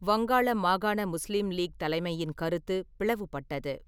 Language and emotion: Tamil, neutral